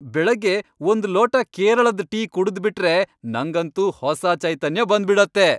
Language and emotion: Kannada, happy